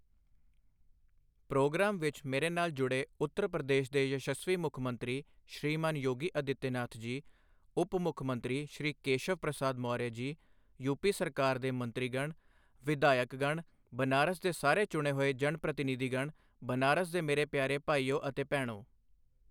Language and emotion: Punjabi, neutral